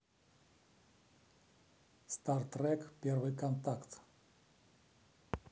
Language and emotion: Russian, neutral